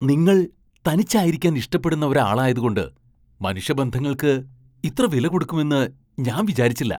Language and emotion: Malayalam, surprised